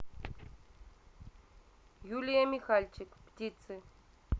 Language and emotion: Russian, neutral